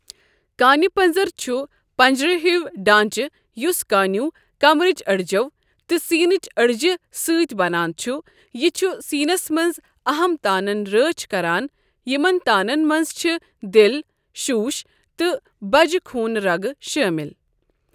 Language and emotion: Kashmiri, neutral